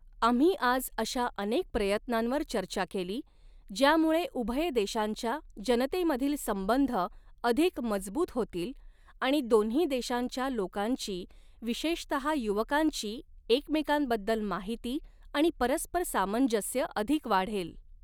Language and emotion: Marathi, neutral